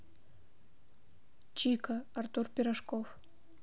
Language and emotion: Russian, neutral